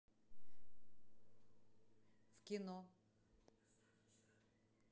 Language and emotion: Russian, neutral